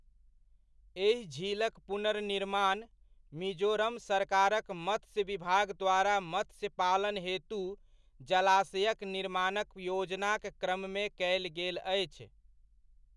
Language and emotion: Maithili, neutral